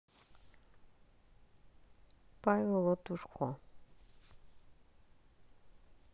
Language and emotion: Russian, neutral